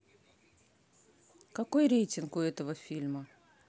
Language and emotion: Russian, neutral